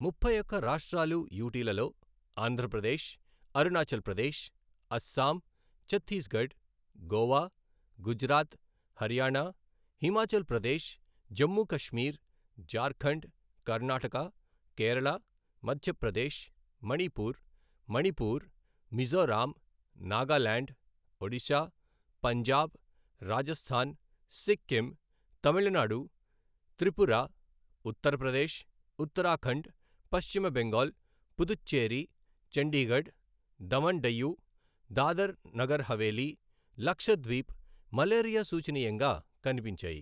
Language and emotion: Telugu, neutral